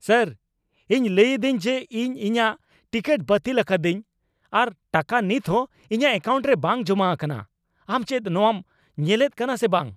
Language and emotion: Santali, angry